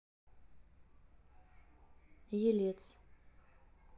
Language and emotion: Russian, neutral